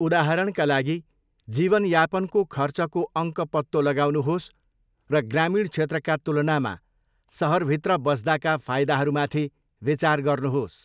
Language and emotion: Nepali, neutral